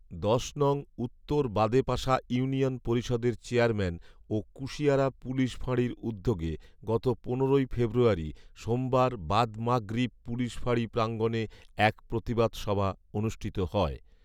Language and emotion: Bengali, neutral